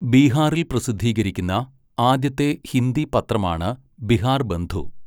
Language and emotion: Malayalam, neutral